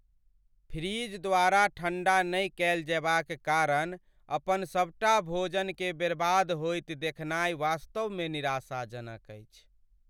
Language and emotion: Maithili, sad